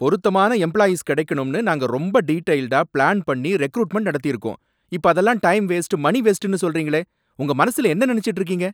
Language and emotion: Tamil, angry